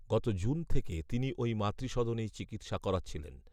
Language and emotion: Bengali, neutral